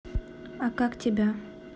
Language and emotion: Russian, neutral